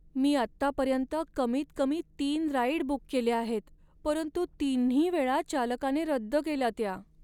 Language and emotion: Marathi, sad